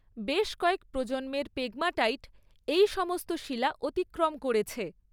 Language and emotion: Bengali, neutral